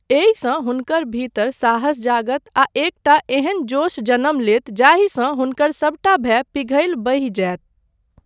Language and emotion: Maithili, neutral